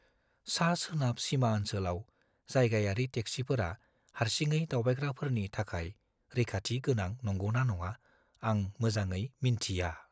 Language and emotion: Bodo, fearful